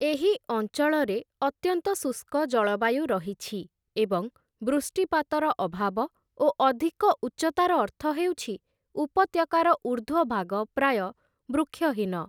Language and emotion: Odia, neutral